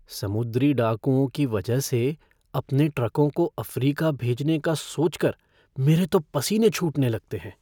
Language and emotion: Hindi, fearful